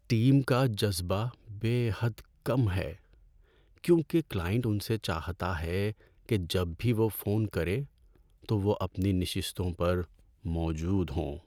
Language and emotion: Urdu, sad